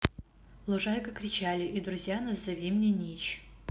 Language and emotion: Russian, neutral